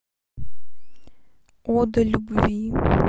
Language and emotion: Russian, neutral